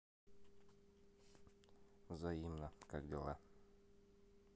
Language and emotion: Russian, neutral